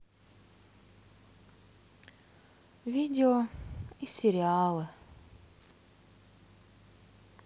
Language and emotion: Russian, sad